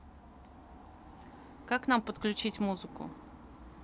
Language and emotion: Russian, neutral